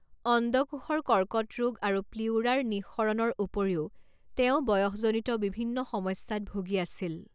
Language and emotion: Assamese, neutral